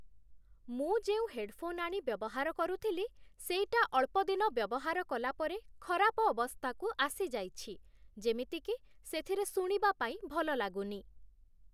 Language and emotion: Odia, neutral